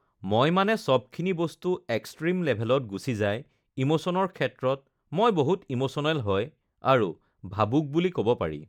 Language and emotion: Assamese, neutral